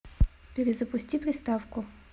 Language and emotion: Russian, neutral